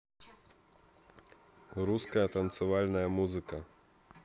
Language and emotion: Russian, neutral